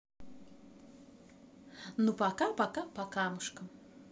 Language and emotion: Russian, positive